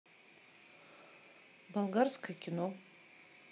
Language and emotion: Russian, neutral